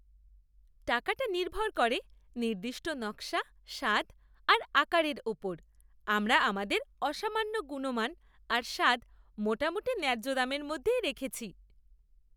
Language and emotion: Bengali, happy